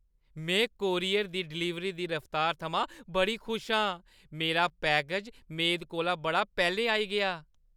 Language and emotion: Dogri, happy